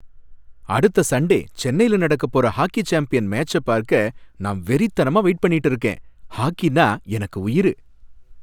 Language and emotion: Tamil, happy